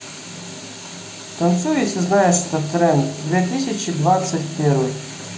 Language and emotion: Russian, neutral